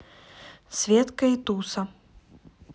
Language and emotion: Russian, neutral